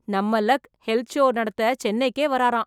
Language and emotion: Tamil, surprised